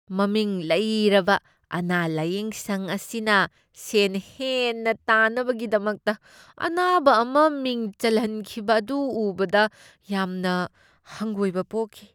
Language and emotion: Manipuri, disgusted